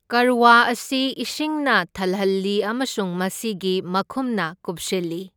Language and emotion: Manipuri, neutral